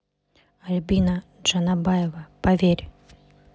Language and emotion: Russian, neutral